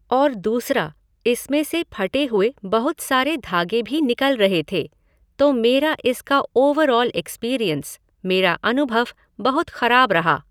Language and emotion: Hindi, neutral